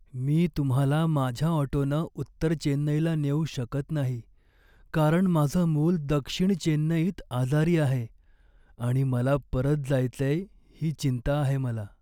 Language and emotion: Marathi, sad